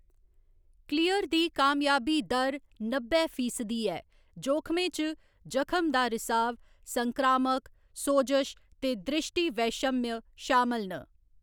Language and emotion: Dogri, neutral